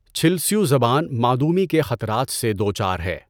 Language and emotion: Urdu, neutral